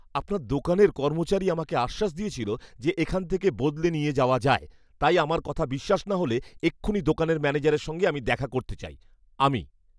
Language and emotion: Bengali, angry